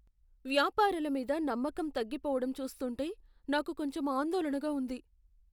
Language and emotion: Telugu, fearful